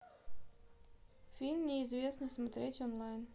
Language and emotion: Russian, neutral